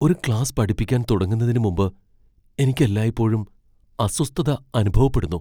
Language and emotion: Malayalam, fearful